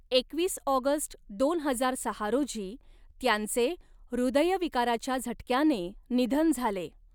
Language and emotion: Marathi, neutral